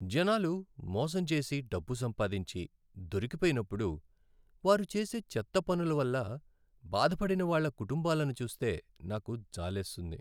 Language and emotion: Telugu, sad